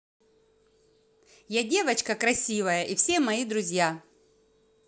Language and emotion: Russian, positive